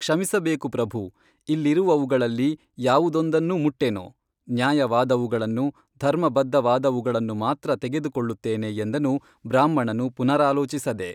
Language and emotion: Kannada, neutral